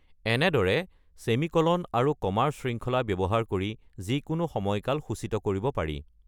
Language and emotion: Assamese, neutral